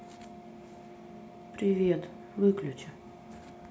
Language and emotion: Russian, sad